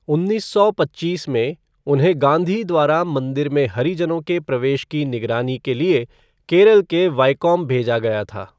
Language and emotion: Hindi, neutral